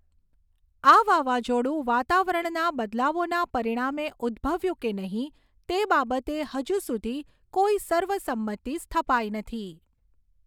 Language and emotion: Gujarati, neutral